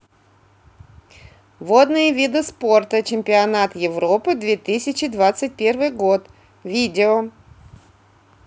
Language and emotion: Russian, neutral